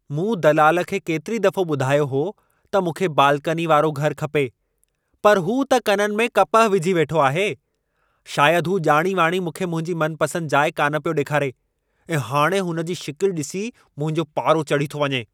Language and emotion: Sindhi, angry